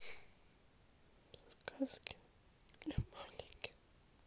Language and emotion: Russian, sad